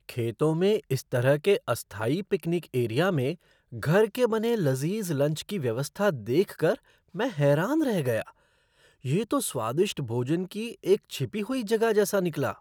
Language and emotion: Hindi, surprised